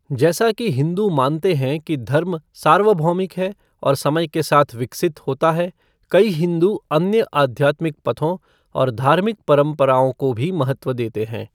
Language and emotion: Hindi, neutral